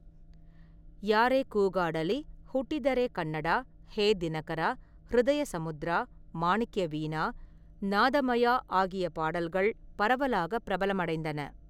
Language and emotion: Tamil, neutral